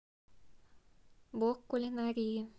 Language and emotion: Russian, neutral